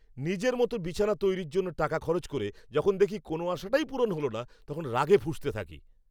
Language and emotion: Bengali, angry